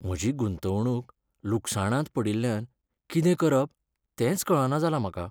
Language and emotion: Goan Konkani, sad